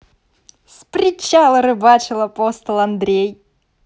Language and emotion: Russian, positive